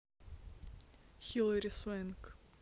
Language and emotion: Russian, neutral